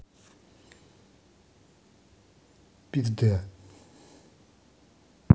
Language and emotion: Russian, neutral